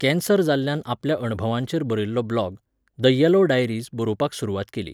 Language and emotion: Goan Konkani, neutral